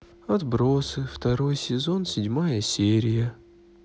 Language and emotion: Russian, sad